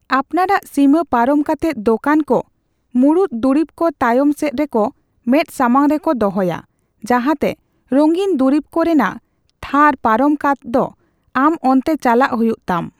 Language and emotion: Santali, neutral